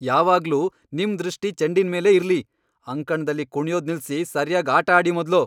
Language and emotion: Kannada, angry